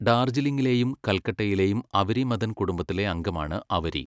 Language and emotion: Malayalam, neutral